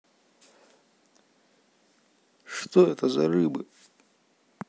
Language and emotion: Russian, neutral